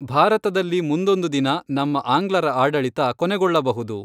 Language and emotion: Kannada, neutral